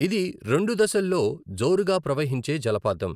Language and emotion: Telugu, neutral